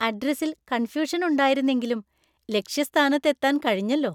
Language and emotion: Malayalam, happy